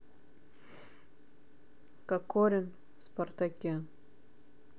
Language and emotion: Russian, neutral